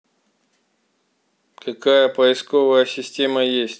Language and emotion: Russian, neutral